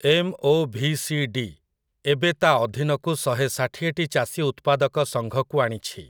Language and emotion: Odia, neutral